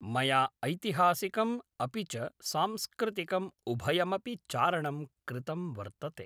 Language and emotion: Sanskrit, neutral